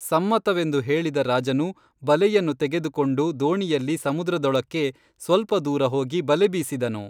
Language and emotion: Kannada, neutral